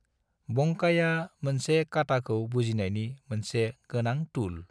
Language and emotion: Bodo, neutral